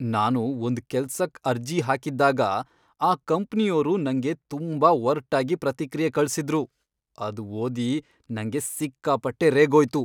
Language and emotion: Kannada, angry